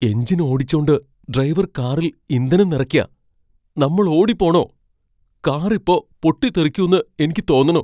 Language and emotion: Malayalam, fearful